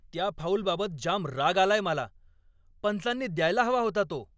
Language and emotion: Marathi, angry